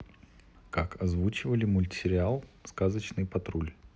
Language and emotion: Russian, neutral